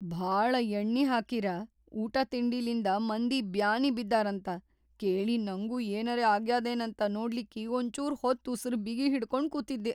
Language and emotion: Kannada, fearful